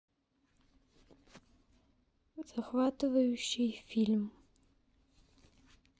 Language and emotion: Russian, neutral